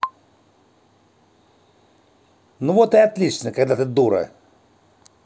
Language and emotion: Russian, angry